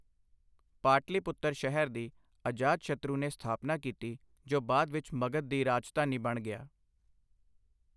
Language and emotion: Punjabi, neutral